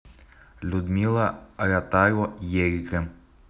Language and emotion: Russian, neutral